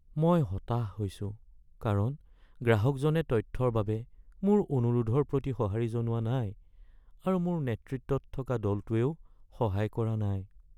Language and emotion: Assamese, sad